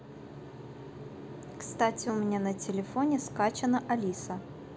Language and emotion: Russian, neutral